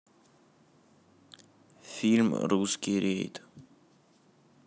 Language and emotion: Russian, neutral